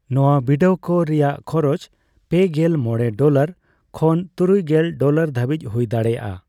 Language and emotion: Santali, neutral